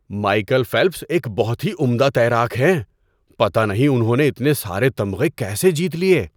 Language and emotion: Urdu, surprised